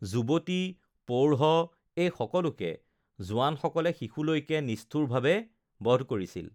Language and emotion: Assamese, neutral